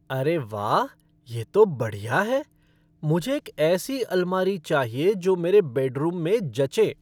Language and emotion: Hindi, happy